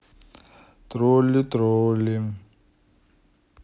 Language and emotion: Russian, neutral